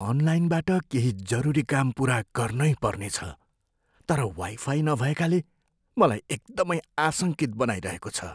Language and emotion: Nepali, fearful